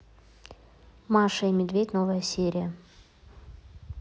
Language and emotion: Russian, neutral